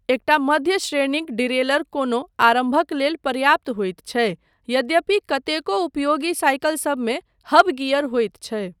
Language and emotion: Maithili, neutral